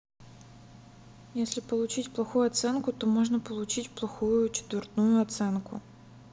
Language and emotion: Russian, sad